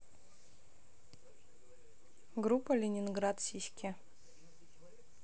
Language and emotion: Russian, neutral